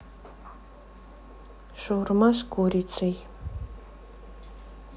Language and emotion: Russian, neutral